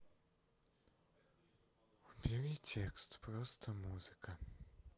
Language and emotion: Russian, sad